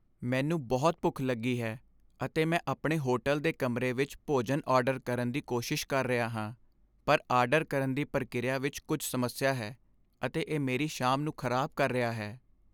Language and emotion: Punjabi, sad